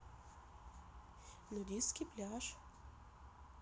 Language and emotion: Russian, neutral